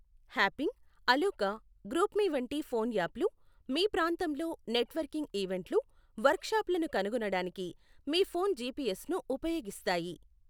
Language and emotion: Telugu, neutral